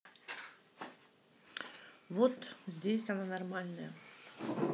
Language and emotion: Russian, neutral